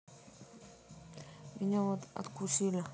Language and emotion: Russian, neutral